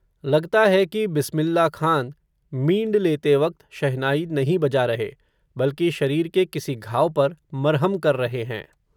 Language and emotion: Hindi, neutral